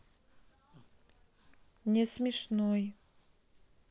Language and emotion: Russian, sad